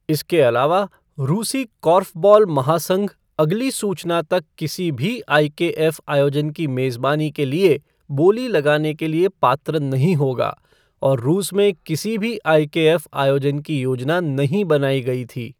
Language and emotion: Hindi, neutral